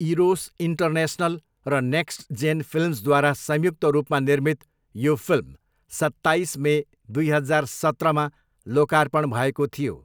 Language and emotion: Nepali, neutral